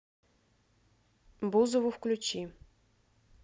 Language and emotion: Russian, neutral